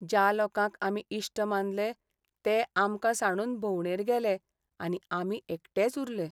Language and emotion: Goan Konkani, sad